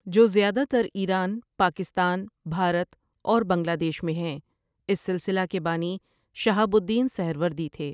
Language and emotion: Urdu, neutral